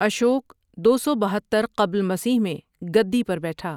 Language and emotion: Urdu, neutral